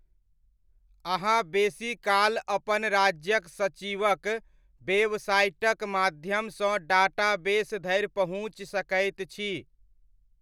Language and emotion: Maithili, neutral